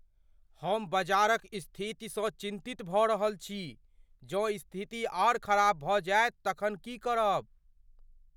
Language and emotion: Maithili, fearful